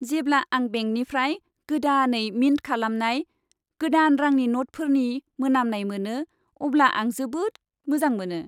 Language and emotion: Bodo, happy